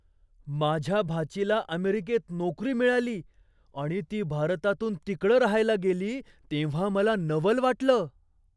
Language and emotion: Marathi, surprised